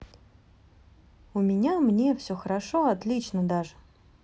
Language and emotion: Russian, positive